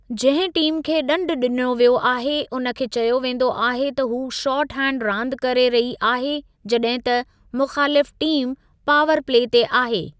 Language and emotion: Sindhi, neutral